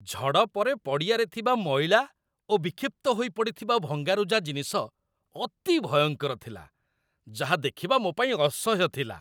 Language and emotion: Odia, disgusted